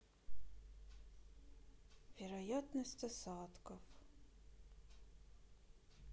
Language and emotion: Russian, sad